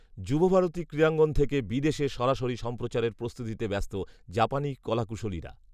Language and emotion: Bengali, neutral